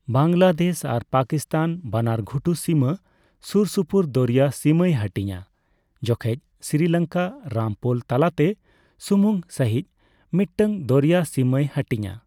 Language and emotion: Santali, neutral